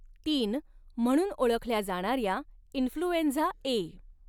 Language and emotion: Marathi, neutral